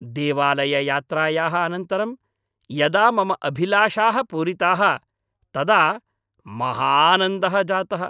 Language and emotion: Sanskrit, happy